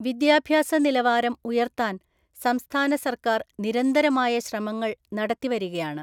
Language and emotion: Malayalam, neutral